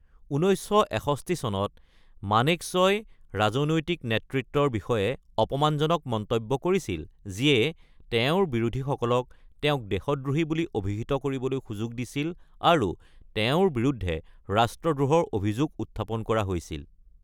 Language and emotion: Assamese, neutral